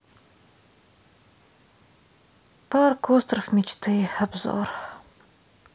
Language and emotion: Russian, sad